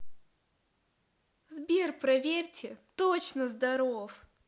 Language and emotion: Russian, positive